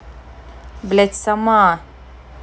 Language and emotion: Russian, angry